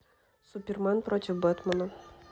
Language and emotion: Russian, neutral